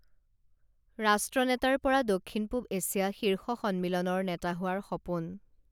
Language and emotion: Assamese, neutral